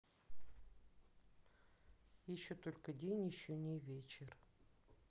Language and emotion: Russian, neutral